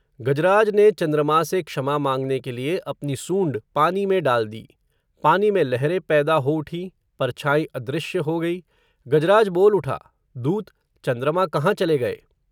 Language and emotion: Hindi, neutral